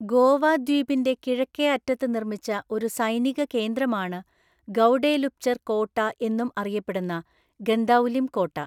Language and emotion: Malayalam, neutral